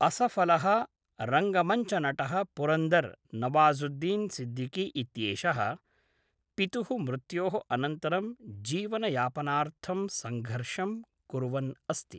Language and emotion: Sanskrit, neutral